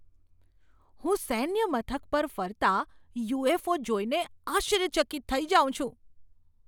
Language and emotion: Gujarati, surprised